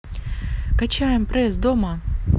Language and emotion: Russian, positive